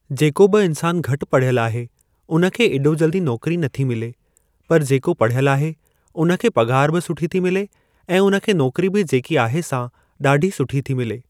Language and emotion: Sindhi, neutral